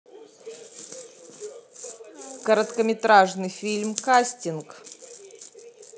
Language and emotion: Russian, neutral